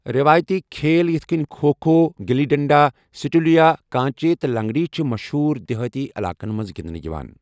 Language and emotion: Kashmiri, neutral